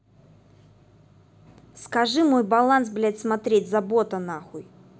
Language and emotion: Russian, angry